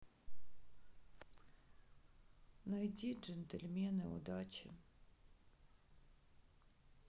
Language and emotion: Russian, sad